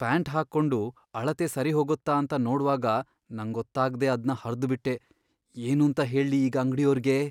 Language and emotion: Kannada, fearful